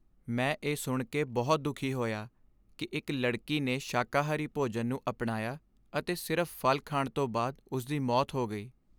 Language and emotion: Punjabi, sad